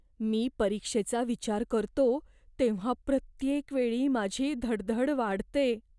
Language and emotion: Marathi, fearful